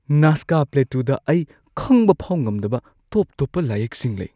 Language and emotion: Manipuri, surprised